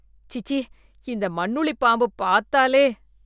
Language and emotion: Tamil, disgusted